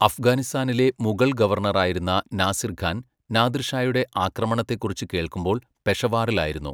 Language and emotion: Malayalam, neutral